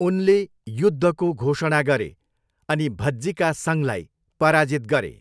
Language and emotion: Nepali, neutral